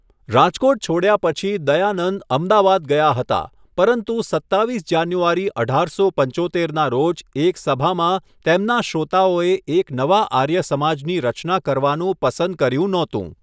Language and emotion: Gujarati, neutral